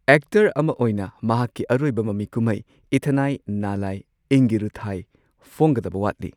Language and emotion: Manipuri, neutral